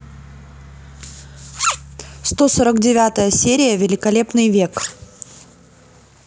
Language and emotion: Russian, neutral